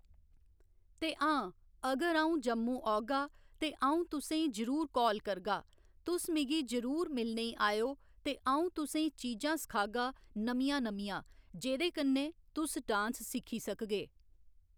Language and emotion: Dogri, neutral